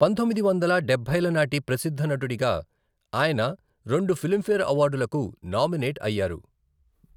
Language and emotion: Telugu, neutral